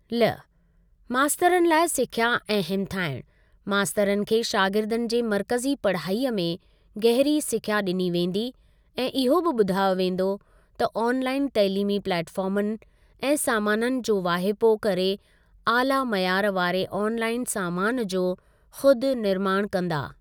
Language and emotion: Sindhi, neutral